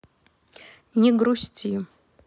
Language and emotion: Russian, neutral